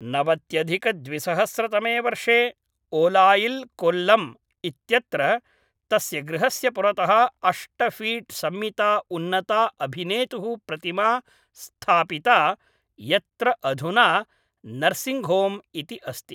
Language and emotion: Sanskrit, neutral